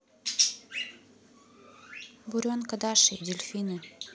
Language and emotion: Russian, neutral